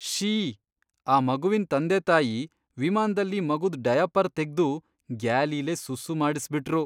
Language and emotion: Kannada, disgusted